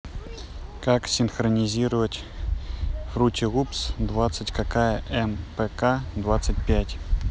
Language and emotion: Russian, neutral